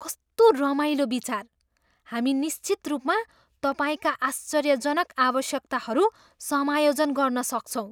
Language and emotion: Nepali, surprised